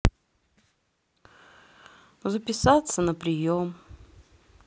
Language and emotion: Russian, sad